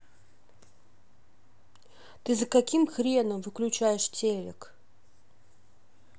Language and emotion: Russian, angry